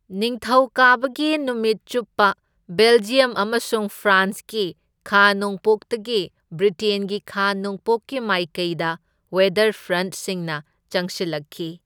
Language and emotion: Manipuri, neutral